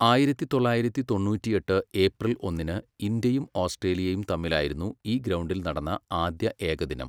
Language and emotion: Malayalam, neutral